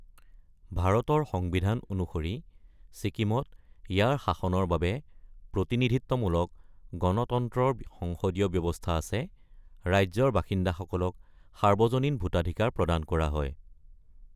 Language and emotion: Assamese, neutral